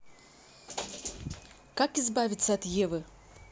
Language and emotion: Russian, neutral